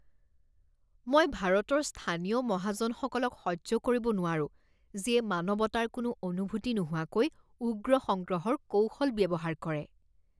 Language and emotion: Assamese, disgusted